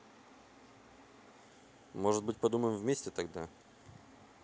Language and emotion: Russian, neutral